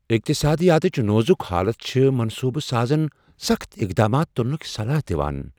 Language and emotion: Kashmiri, fearful